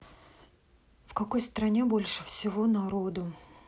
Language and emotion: Russian, neutral